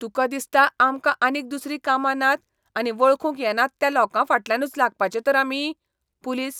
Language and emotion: Goan Konkani, disgusted